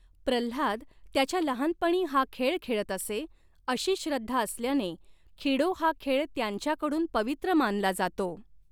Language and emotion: Marathi, neutral